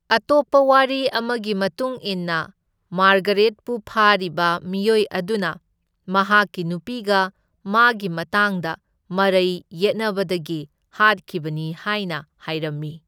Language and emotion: Manipuri, neutral